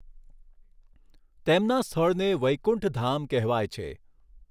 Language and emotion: Gujarati, neutral